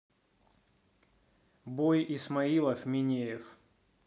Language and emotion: Russian, neutral